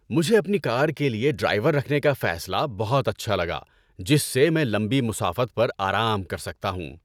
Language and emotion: Urdu, happy